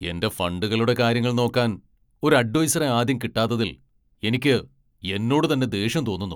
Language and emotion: Malayalam, angry